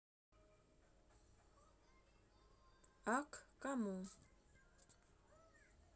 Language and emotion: Russian, neutral